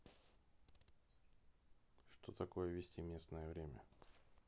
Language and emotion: Russian, neutral